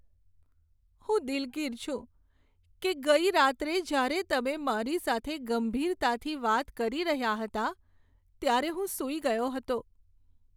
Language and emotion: Gujarati, sad